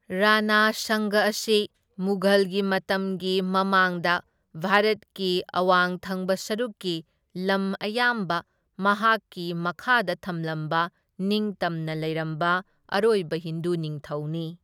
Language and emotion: Manipuri, neutral